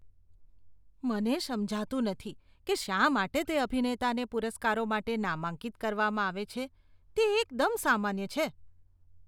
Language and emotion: Gujarati, disgusted